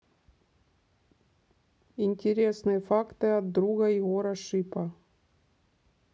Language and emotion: Russian, neutral